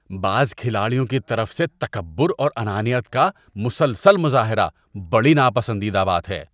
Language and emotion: Urdu, disgusted